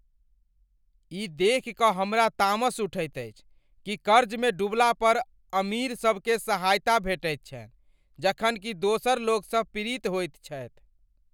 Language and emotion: Maithili, angry